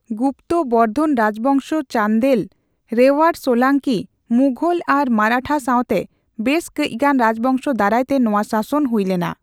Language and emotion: Santali, neutral